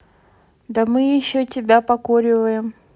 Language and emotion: Russian, neutral